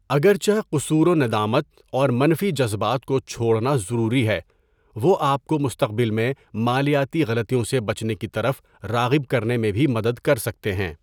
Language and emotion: Urdu, neutral